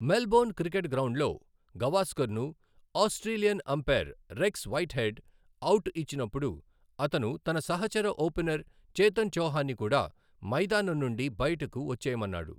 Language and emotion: Telugu, neutral